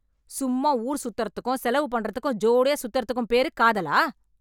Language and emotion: Tamil, angry